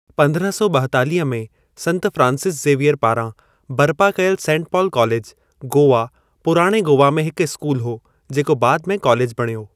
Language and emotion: Sindhi, neutral